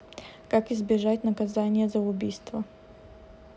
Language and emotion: Russian, neutral